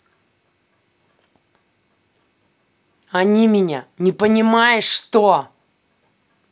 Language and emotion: Russian, angry